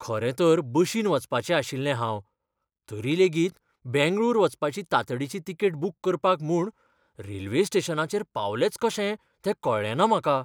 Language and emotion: Goan Konkani, fearful